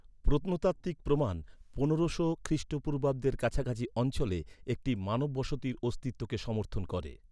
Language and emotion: Bengali, neutral